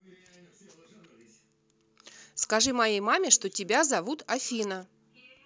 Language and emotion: Russian, neutral